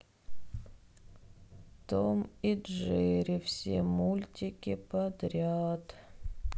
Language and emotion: Russian, sad